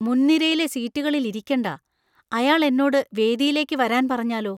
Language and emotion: Malayalam, fearful